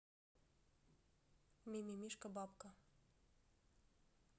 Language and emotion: Russian, neutral